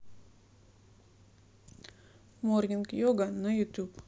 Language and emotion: Russian, neutral